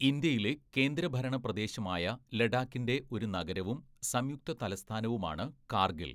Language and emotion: Malayalam, neutral